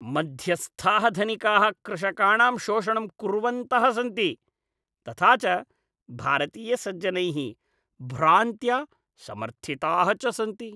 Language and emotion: Sanskrit, disgusted